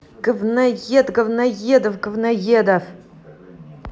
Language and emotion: Russian, angry